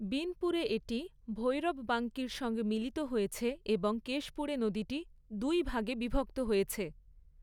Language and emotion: Bengali, neutral